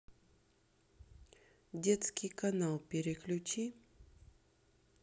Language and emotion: Russian, neutral